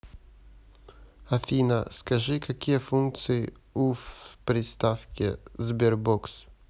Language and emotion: Russian, neutral